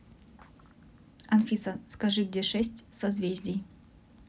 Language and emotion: Russian, neutral